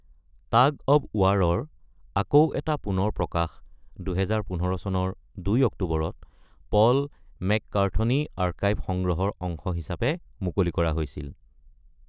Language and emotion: Assamese, neutral